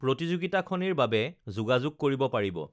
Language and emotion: Assamese, neutral